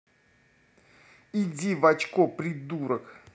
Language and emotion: Russian, angry